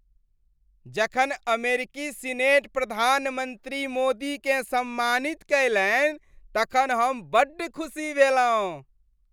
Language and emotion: Maithili, happy